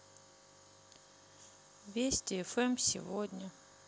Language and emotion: Russian, sad